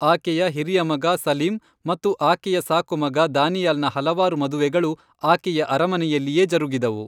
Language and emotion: Kannada, neutral